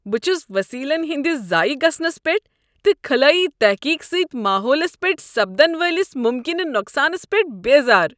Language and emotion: Kashmiri, disgusted